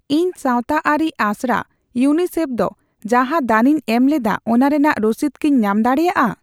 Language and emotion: Santali, neutral